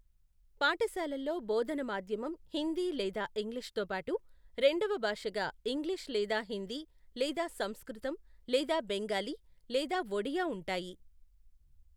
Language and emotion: Telugu, neutral